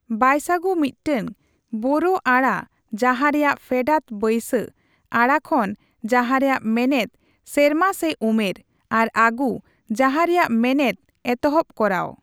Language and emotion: Santali, neutral